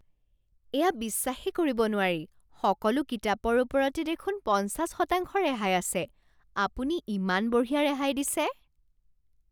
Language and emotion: Assamese, surprised